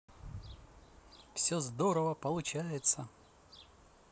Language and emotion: Russian, positive